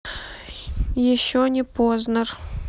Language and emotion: Russian, neutral